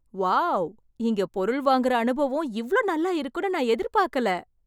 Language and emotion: Tamil, surprised